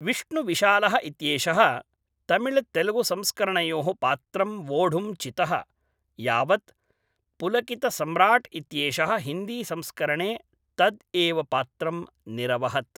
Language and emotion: Sanskrit, neutral